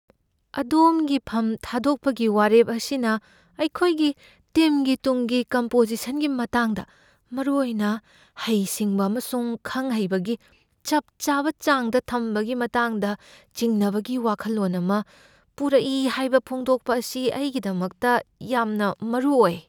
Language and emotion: Manipuri, fearful